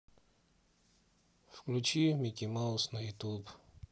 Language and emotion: Russian, sad